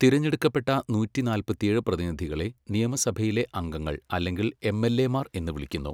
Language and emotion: Malayalam, neutral